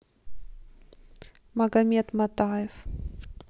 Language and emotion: Russian, neutral